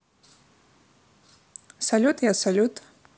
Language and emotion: Russian, positive